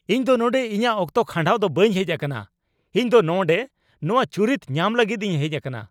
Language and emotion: Santali, angry